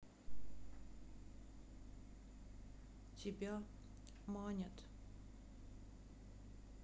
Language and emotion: Russian, sad